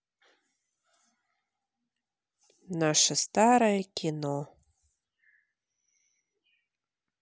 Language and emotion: Russian, sad